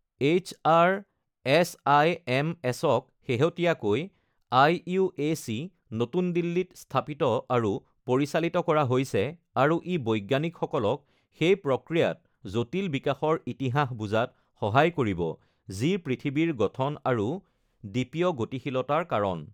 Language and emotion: Assamese, neutral